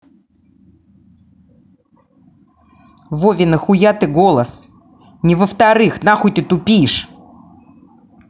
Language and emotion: Russian, angry